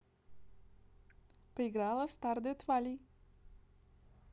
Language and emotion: Russian, neutral